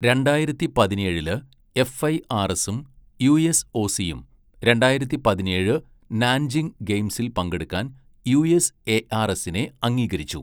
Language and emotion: Malayalam, neutral